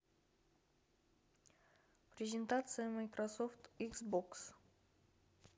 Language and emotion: Russian, neutral